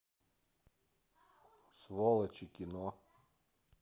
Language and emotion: Russian, neutral